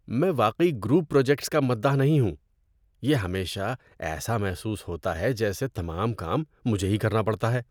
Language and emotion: Urdu, disgusted